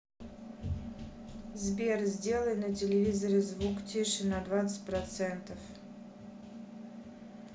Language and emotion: Russian, neutral